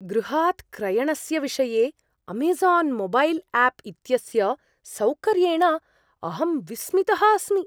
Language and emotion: Sanskrit, surprised